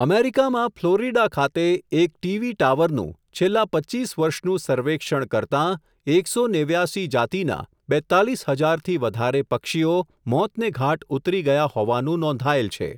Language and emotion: Gujarati, neutral